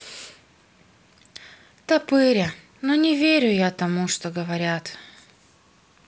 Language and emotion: Russian, sad